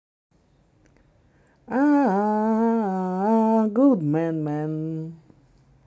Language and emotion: Russian, positive